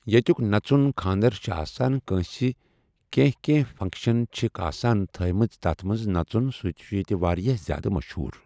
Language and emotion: Kashmiri, neutral